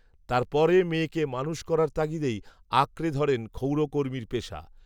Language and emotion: Bengali, neutral